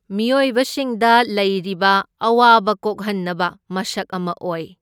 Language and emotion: Manipuri, neutral